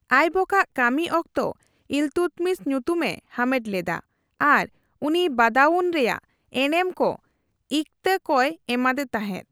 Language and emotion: Santali, neutral